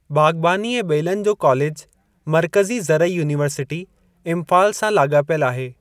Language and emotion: Sindhi, neutral